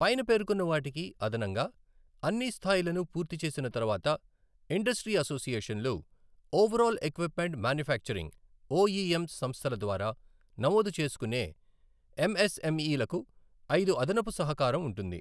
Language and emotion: Telugu, neutral